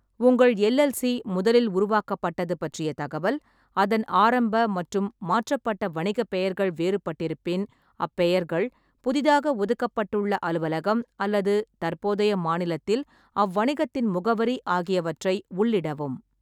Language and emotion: Tamil, neutral